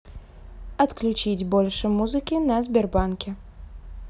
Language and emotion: Russian, neutral